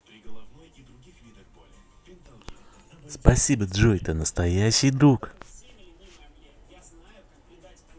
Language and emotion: Russian, positive